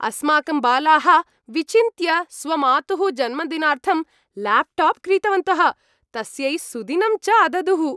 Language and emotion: Sanskrit, happy